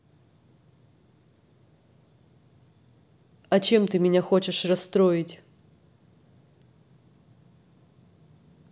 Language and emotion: Russian, neutral